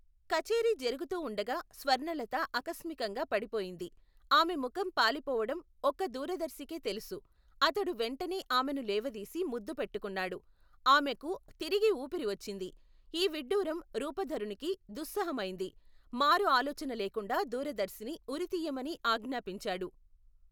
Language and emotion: Telugu, neutral